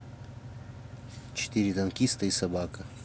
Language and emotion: Russian, neutral